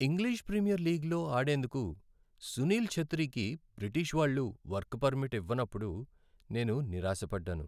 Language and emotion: Telugu, sad